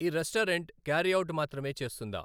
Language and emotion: Telugu, neutral